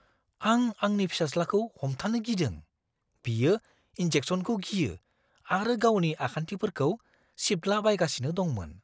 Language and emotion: Bodo, fearful